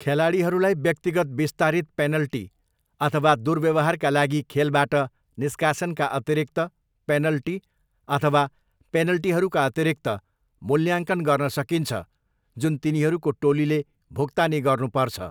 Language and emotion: Nepali, neutral